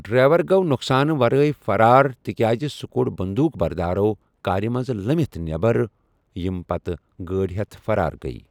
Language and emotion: Kashmiri, neutral